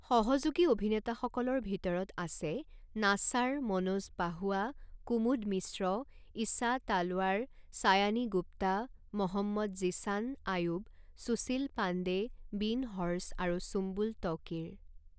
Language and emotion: Assamese, neutral